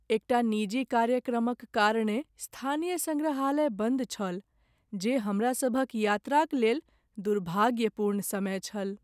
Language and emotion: Maithili, sad